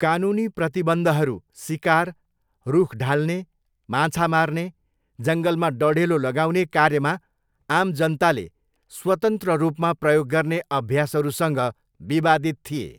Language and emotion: Nepali, neutral